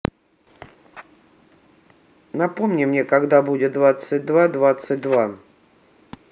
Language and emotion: Russian, neutral